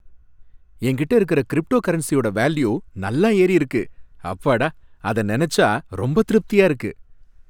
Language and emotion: Tamil, happy